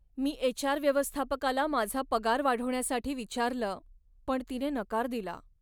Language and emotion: Marathi, sad